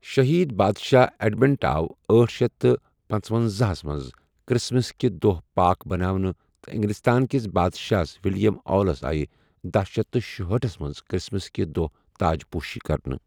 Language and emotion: Kashmiri, neutral